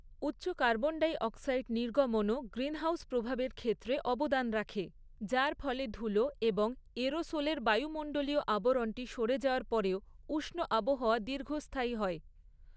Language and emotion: Bengali, neutral